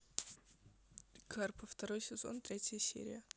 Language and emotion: Russian, neutral